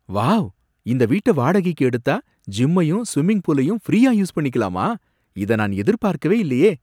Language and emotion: Tamil, surprised